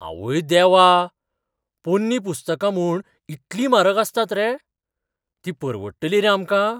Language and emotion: Goan Konkani, surprised